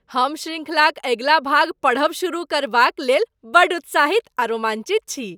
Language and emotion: Maithili, happy